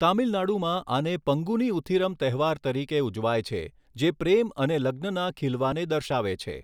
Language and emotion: Gujarati, neutral